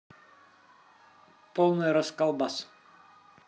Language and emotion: Russian, positive